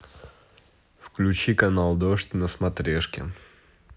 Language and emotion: Russian, neutral